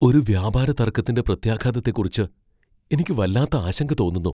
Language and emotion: Malayalam, fearful